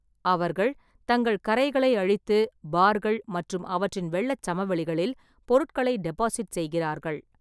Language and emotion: Tamil, neutral